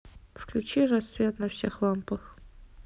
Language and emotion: Russian, neutral